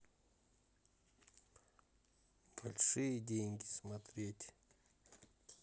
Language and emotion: Russian, neutral